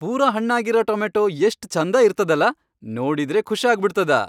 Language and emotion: Kannada, happy